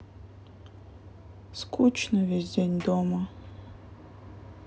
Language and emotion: Russian, sad